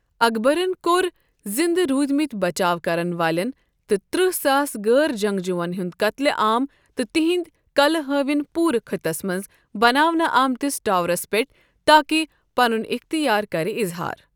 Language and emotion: Kashmiri, neutral